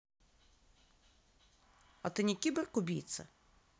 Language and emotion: Russian, neutral